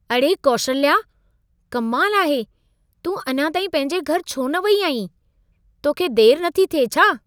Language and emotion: Sindhi, surprised